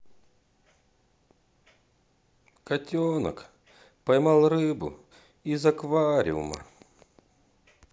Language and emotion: Russian, sad